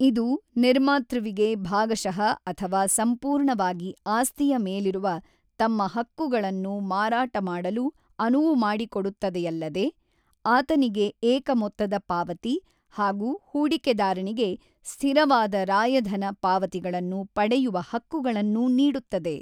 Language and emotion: Kannada, neutral